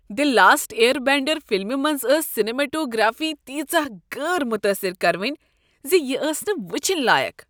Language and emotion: Kashmiri, disgusted